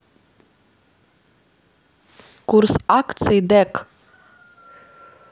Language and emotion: Russian, neutral